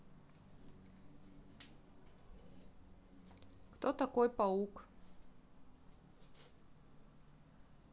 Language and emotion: Russian, neutral